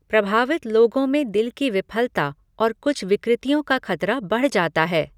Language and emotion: Hindi, neutral